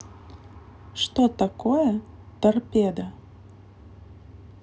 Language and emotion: Russian, neutral